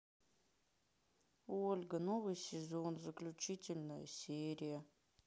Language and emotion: Russian, sad